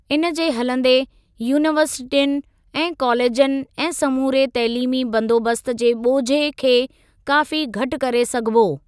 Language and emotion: Sindhi, neutral